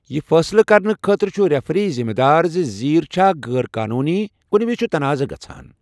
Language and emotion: Kashmiri, neutral